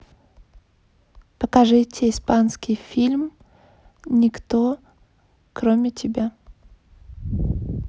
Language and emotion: Russian, neutral